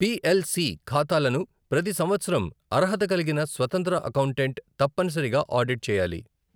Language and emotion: Telugu, neutral